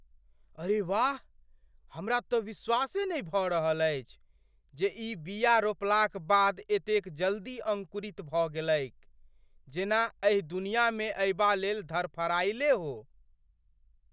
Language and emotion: Maithili, surprised